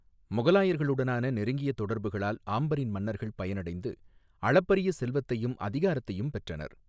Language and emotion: Tamil, neutral